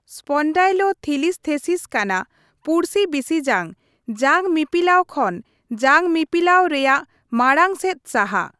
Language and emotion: Santali, neutral